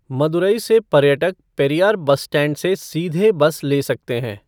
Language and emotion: Hindi, neutral